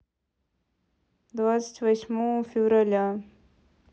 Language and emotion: Russian, neutral